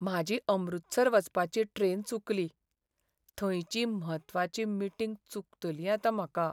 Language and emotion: Goan Konkani, sad